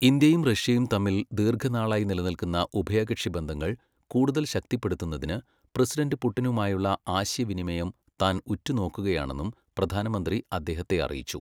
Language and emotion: Malayalam, neutral